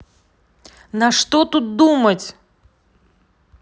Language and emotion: Russian, angry